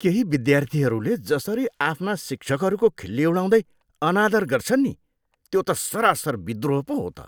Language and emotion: Nepali, disgusted